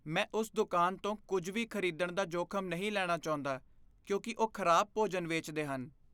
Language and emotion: Punjabi, fearful